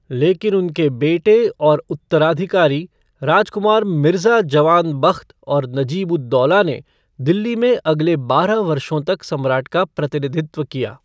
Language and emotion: Hindi, neutral